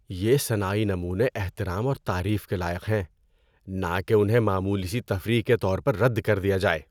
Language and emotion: Urdu, disgusted